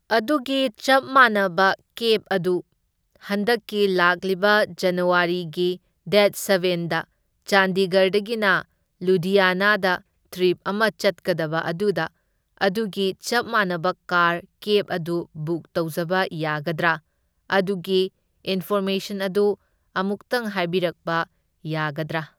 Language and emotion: Manipuri, neutral